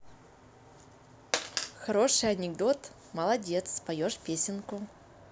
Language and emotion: Russian, positive